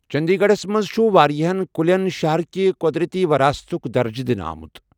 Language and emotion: Kashmiri, neutral